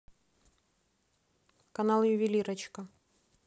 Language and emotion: Russian, neutral